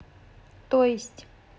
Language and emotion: Russian, neutral